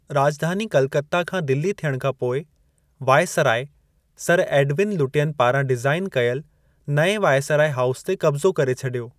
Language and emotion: Sindhi, neutral